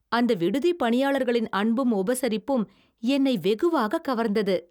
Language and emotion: Tamil, happy